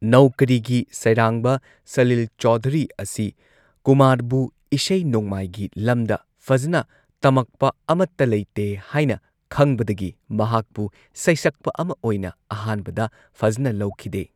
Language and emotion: Manipuri, neutral